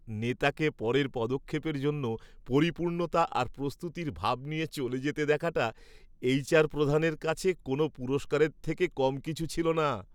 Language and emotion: Bengali, happy